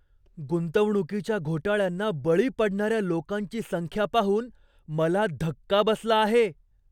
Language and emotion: Marathi, surprised